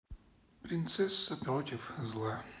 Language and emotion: Russian, sad